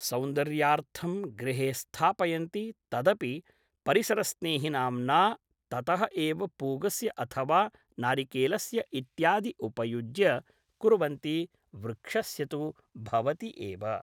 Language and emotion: Sanskrit, neutral